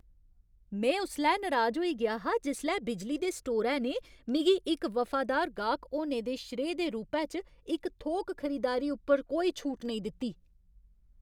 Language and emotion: Dogri, angry